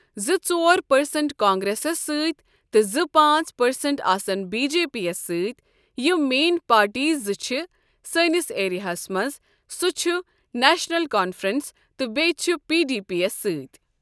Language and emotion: Kashmiri, neutral